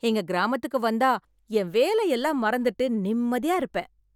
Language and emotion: Tamil, happy